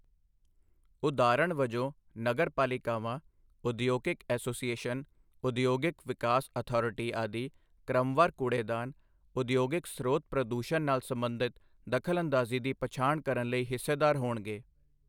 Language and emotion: Punjabi, neutral